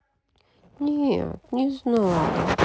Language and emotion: Russian, sad